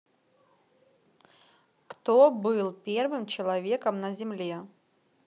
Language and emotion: Russian, neutral